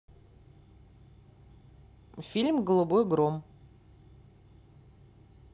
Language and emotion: Russian, neutral